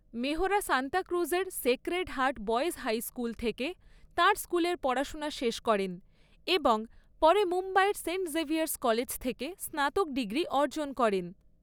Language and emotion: Bengali, neutral